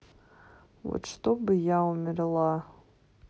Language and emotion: Russian, sad